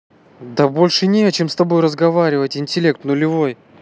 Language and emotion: Russian, angry